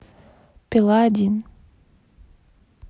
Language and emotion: Russian, neutral